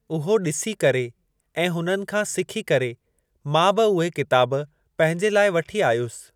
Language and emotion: Sindhi, neutral